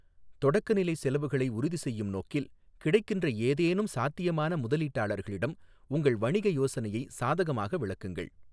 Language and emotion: Tamil, neutral